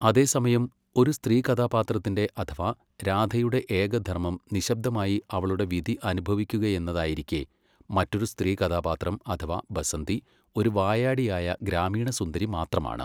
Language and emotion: Malayalam, neutral